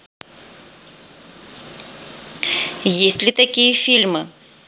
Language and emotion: Russian, neutral